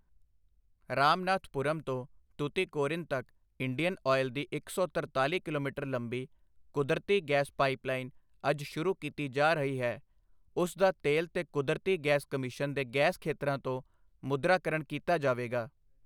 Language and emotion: Punjabi, neutral